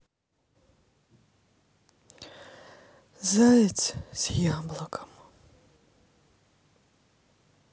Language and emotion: Russian, sad